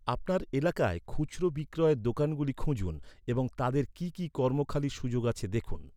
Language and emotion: Bengali, neutral